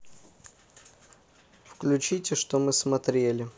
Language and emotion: Russian, neutral